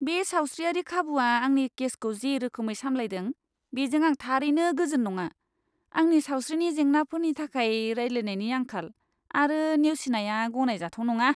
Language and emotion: Bodo, disgusted